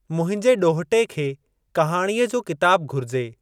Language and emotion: Sindhi, neutral